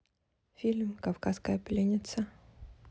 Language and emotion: Russian, neutral